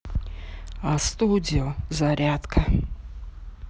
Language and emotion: Russian, neutral